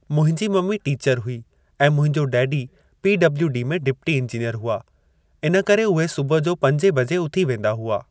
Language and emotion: Sindhi, neutral